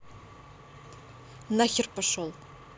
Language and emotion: Russian, angry